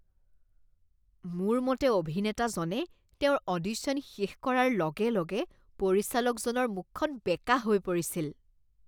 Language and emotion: Assamese, disgusted